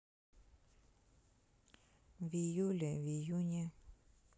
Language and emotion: Russian, neutral